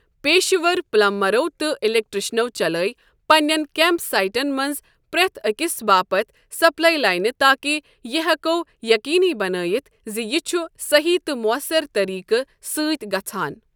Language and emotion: Kashmiri, neutral